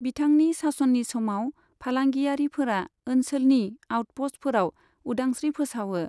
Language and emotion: Bodo, neutral